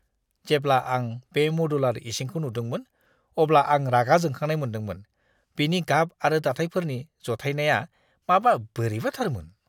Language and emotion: Bodo, disgusted